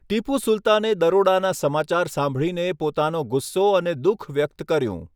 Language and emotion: Gujarati, neutral